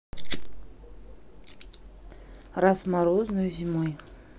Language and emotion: Russian, neutral